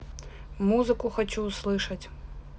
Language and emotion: Russian, neutral